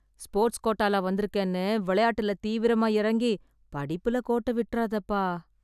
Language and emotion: Tamil, sad